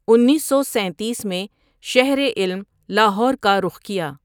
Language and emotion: Urdu, neutral